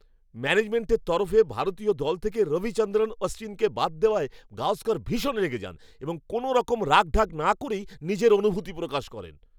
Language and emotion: Bengali, angry